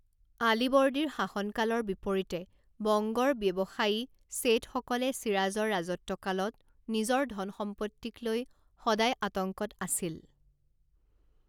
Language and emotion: Assamese, neutral